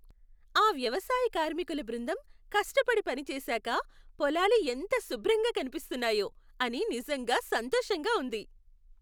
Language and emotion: Telugu, happy